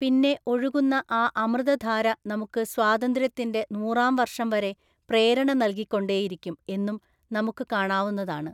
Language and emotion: Malayalam, neutral